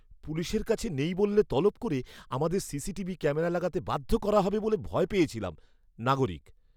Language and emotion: Bengali, fearful